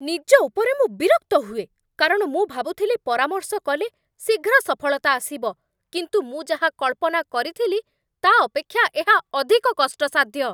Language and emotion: Odia, angry